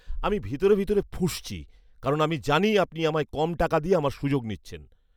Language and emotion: Bengali, angry